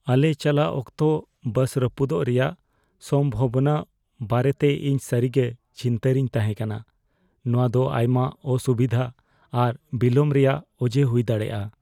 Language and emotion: Santali, fearful